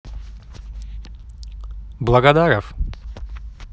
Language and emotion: Russian, neutral